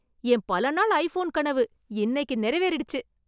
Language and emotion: Tamil, happy